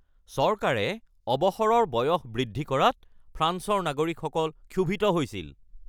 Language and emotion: Assamese, angry